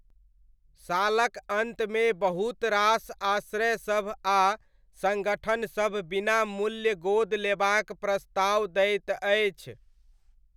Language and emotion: Maithili, neutral